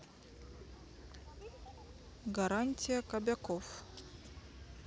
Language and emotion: Russian, neutral